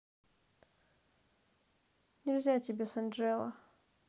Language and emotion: Russian, neutral